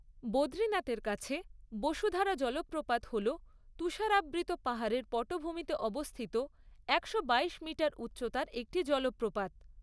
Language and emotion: Bengali, neutral